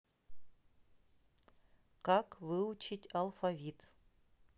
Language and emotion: Russian, neutral